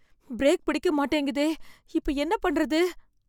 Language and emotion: Tamil, fearful